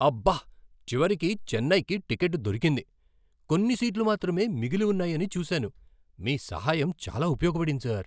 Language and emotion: Telugu, surprised